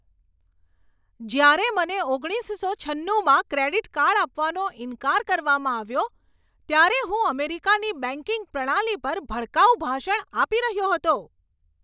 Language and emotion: Gujarati, angry